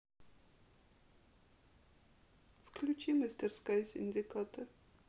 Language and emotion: Russian, sad